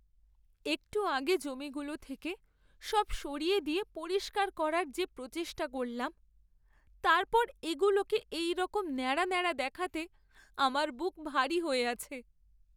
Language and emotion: Bengali, sad